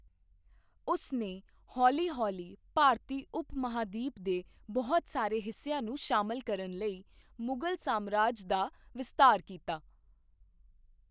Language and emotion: Punjabi, neutral